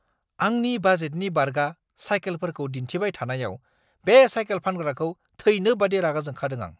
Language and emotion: Bodo, angry